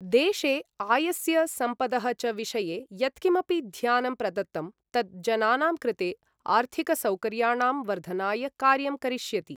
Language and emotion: Sanskrit, neutral